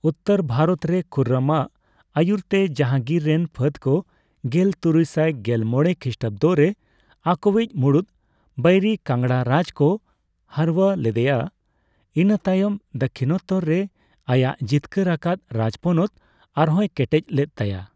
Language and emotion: Santali, neutral